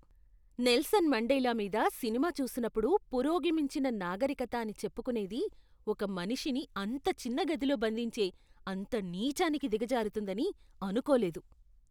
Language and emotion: Telugu, disgusted